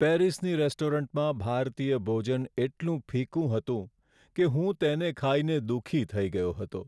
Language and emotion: Gujarati, sad